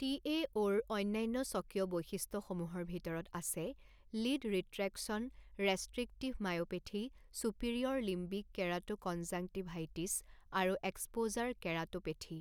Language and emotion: Assamese, neutral